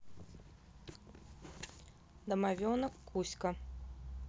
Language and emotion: Russian, neutral